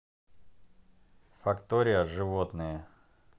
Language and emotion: Russian, neutral